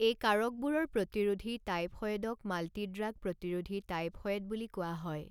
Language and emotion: Assamese, neutral